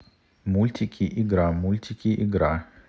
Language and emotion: Russian, neutral